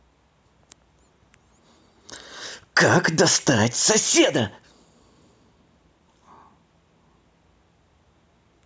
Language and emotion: Russian, angry